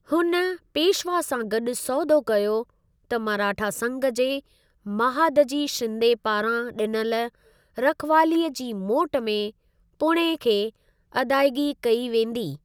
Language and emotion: Sindhi, neutral